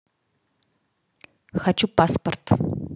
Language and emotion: Russian, neutral